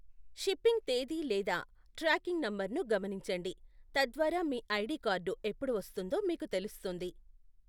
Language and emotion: Telugu, neutral